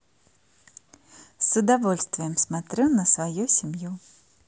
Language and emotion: Russian, positive